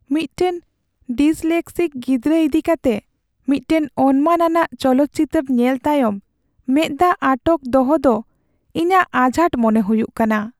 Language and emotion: Santali, sad